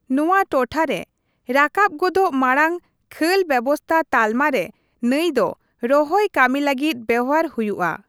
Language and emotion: Santali, neutral